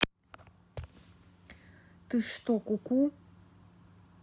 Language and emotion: Russian, angry